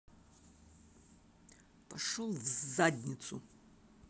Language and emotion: Russian, angry